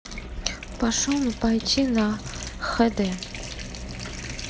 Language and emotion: Russian, neutral